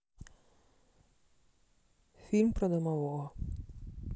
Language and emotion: Russian, neutral